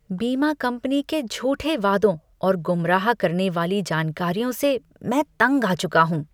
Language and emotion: Hindi, disgusted